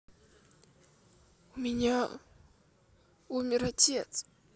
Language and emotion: Russian, sad